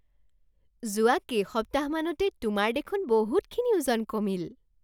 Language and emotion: Assamese, surprised